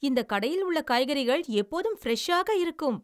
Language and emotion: Tamil, happy